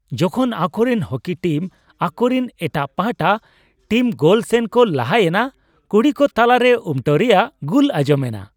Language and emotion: Santali, happy